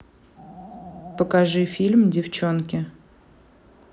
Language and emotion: Russian, neutral